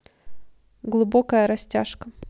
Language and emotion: Russian, neutral